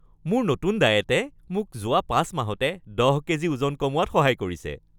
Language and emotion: Assamese, happy